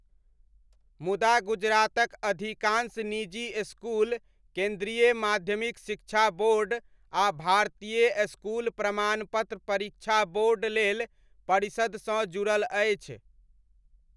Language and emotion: Maithili, neutral